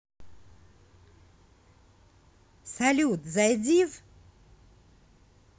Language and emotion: Russian, positive